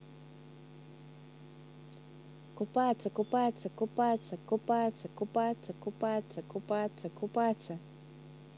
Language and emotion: Russian, positive